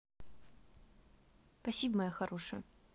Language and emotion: Russian, positive